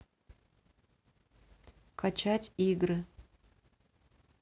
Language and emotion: Russian, neutral